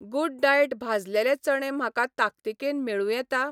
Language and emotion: Goan Konkani, neutral